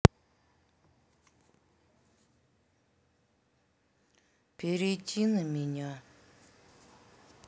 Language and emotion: Russian, sad